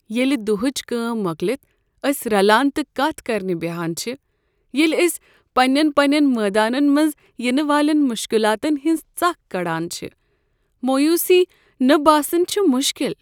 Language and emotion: Kashmiri, sad